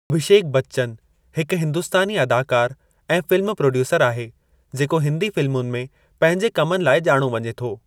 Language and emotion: Sindhi, neutral